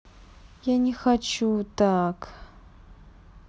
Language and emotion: Russian, sad